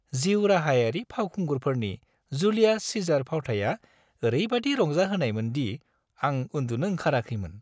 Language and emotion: Bodo, happy